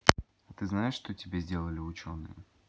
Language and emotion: Russian, neutral